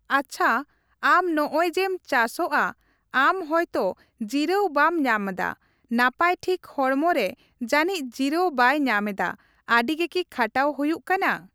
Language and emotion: Santali, neutral